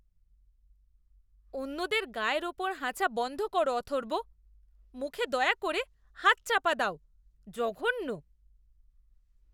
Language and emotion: Bengali, disgusted